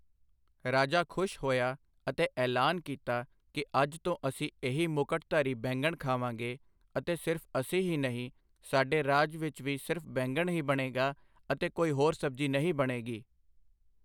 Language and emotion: Punjabi, neutral